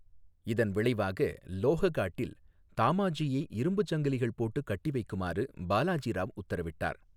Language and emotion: Tamil, neutral